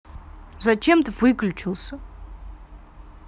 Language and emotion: Russian, angry